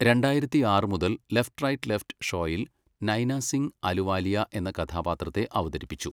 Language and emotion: Malayalam, neutral